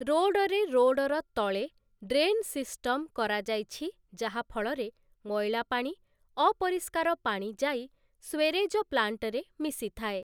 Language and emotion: Odia, neutral